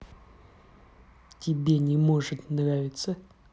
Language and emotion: Russian, neutral